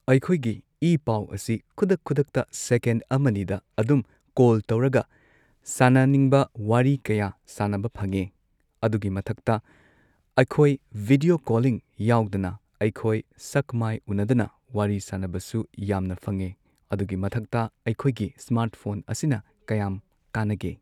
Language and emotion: Manipuri, neutral